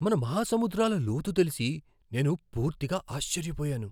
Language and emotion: Telugu, surprised